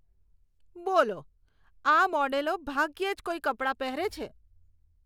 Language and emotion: Gujarati, disgusted